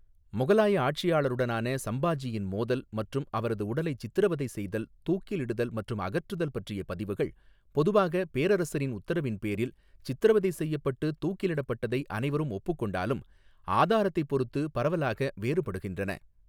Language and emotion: Tamil, neutral